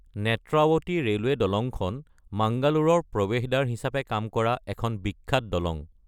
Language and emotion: Assamese, neutral